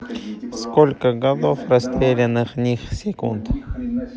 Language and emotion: Russian, neutral